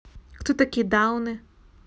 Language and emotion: Russian, neutral